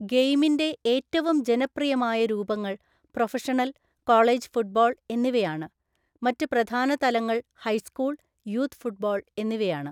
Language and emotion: Malayalam, neutral